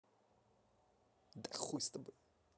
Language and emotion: Russian, angry